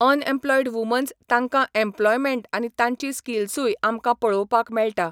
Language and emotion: Goan Konkani, neutral